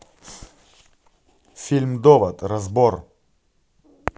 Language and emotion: Russian, neutral